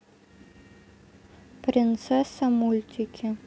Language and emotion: Russian, neutral